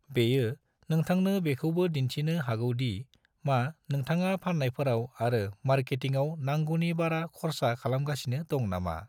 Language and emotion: Bodo, neutral